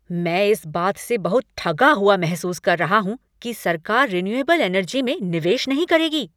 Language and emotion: Hindi, angry